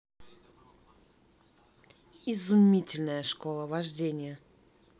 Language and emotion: Russian, positive